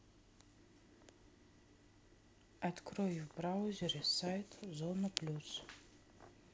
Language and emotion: Russian, neutral